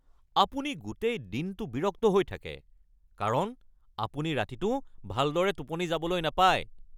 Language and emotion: Assamese, angry